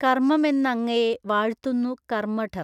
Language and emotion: Malayalam, neutral